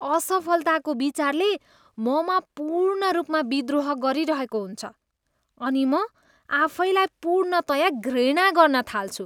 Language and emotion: Nepali, disgusted